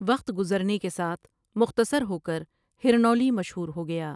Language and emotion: Urdu, neutral